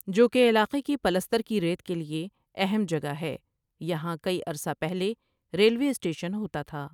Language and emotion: Urdu, neutral